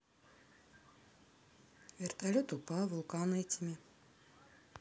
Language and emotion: Russian, neutral